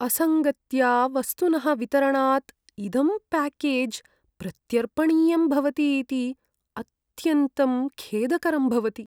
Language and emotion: Sanskrit, sad